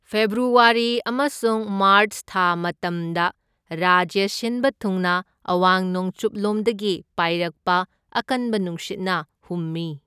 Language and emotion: Manipuri, neutral